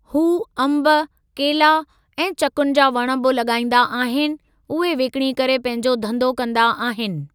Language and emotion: Sindhi, neutral